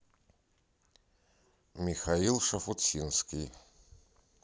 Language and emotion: Russian, neutral